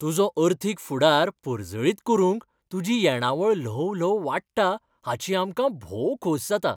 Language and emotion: Goan Konkani, happy